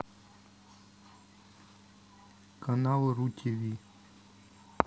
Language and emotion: Russian, neutral